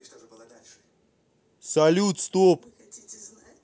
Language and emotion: Russian, angry